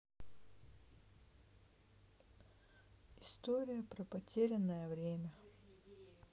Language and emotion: Russian, sad